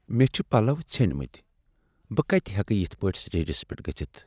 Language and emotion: Kashmiri, sad